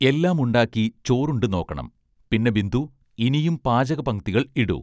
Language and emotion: Malayalam, neutral